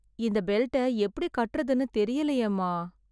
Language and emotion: Tamil, sad